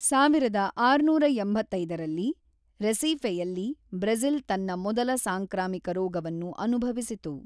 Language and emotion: Kannada, neutral